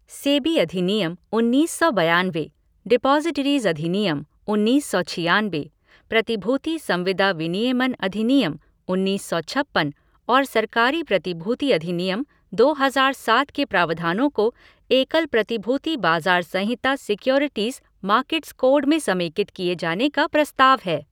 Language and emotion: Hindi, neutral